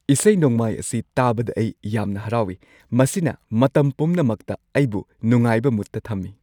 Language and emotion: Manipuri, happy